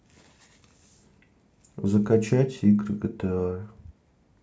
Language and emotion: Russian, sad